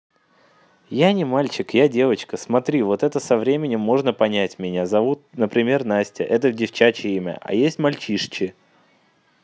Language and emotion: Russian, neutral